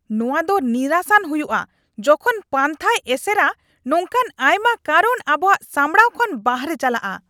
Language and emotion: Santali, angry